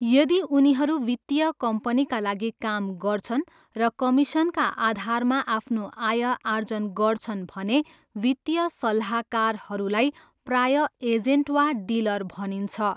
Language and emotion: Nepali, neutral